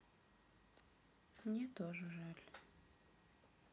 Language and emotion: Russian, sad